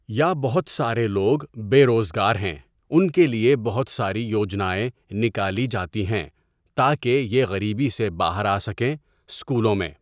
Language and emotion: Urdu, neutral